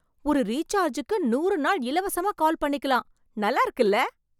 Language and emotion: Tamil, surprised